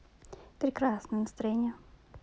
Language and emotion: Russian, positive